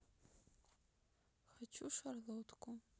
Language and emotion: Russian, sad